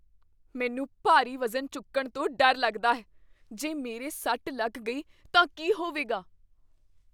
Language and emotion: Punjabi, fearful